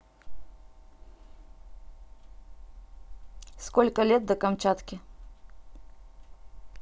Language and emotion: Russian, neutral